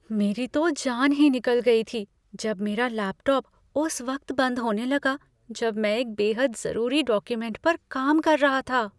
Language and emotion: Hindi, fearful